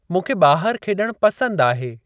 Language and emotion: Sindhi, neutral